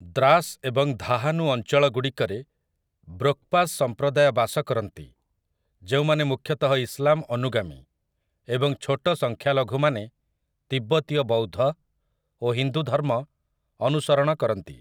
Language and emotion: Odia, neutral